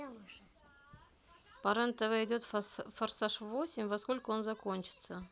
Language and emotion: Russian, neutral